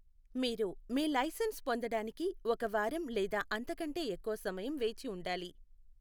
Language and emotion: Telugu, neutral